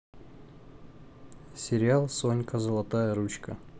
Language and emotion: Russian, neutral